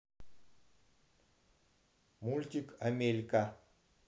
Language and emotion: Russian, neutral